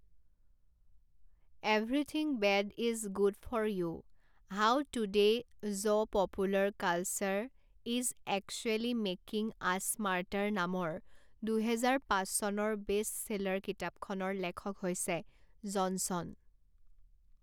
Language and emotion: Assamese, neutral